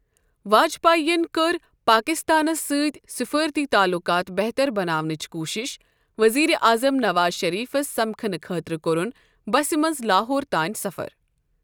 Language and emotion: Kashmiri, neutral